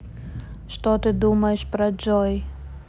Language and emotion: Russian, neutral